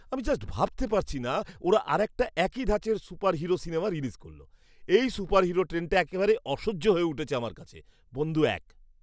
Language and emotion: Bengali, disgusted